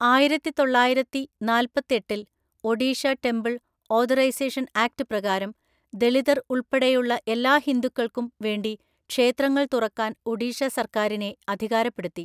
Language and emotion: Malayalam, neutral